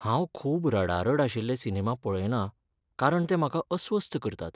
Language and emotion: Goan Konkani, sad